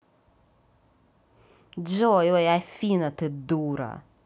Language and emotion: Russian, angry